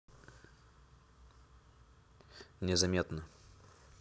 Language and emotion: Russian, neutral